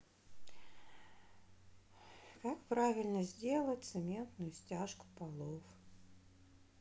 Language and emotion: Russian, sad